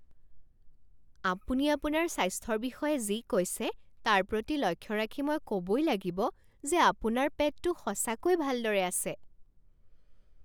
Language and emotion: Assamese, surprised